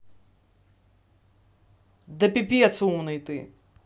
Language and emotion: Russian, angry